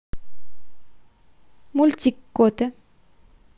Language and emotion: Russian, neutral